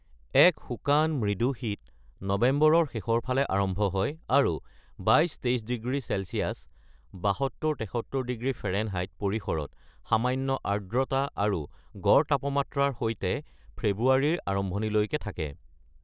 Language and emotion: Assamese, neutral